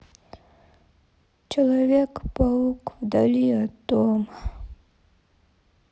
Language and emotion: Russian, sad